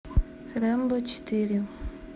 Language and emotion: Russian, neutral